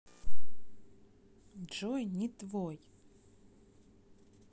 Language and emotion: Russian, neutral